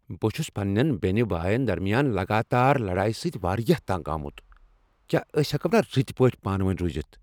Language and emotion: Kashmiri, angry